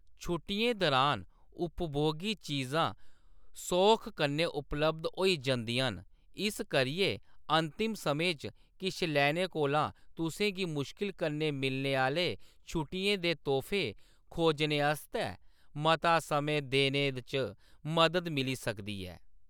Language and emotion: Dogri, neutral